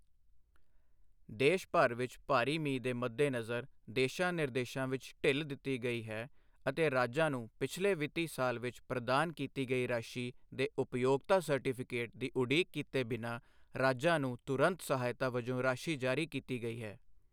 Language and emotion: Punjabi, neutral